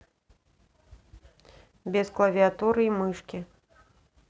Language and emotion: Russian, neutral